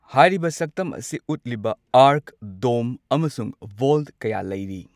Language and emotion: Manipuri, neutral